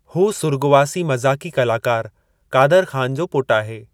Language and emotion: Sindhi, neutral